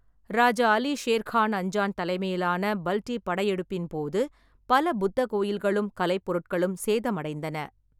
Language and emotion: Tamil, neutral